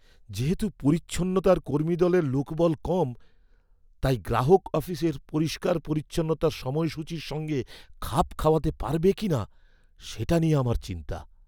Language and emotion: Bengali, fearful